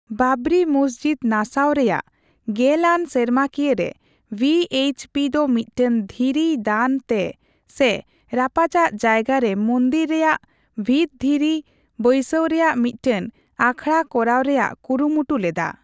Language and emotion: Santali, neutral